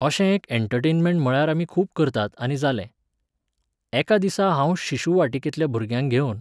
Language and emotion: Goan Konkani, neutral